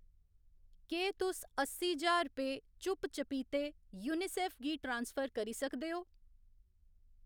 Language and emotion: Dogri, neutral